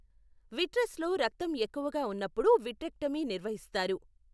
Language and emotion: Telugu, neutral